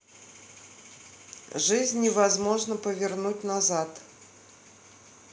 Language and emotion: Russian, neutral